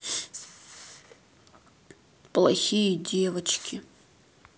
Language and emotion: Russian, sad